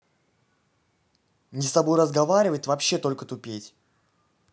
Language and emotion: Russian, angry